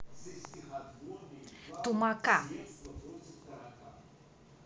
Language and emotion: Russian, neutral